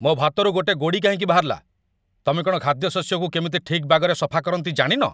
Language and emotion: Odia, angry